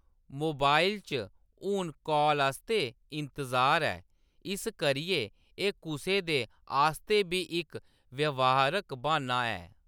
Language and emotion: Dogri, neutral